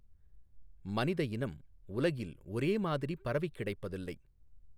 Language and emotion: Tamil, neutral